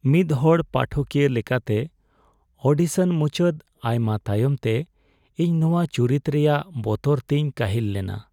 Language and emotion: Santali, sad